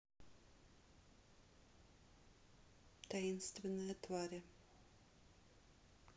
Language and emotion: Russian, neutral